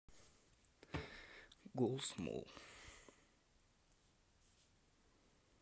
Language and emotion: Russian, sad